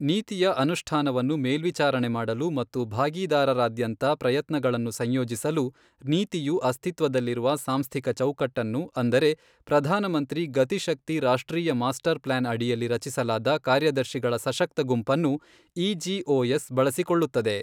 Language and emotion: Kannada, neutral